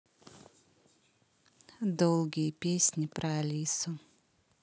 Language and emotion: Russian, neutral